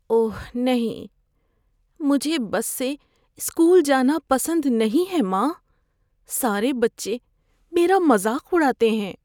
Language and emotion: Urdu, fearful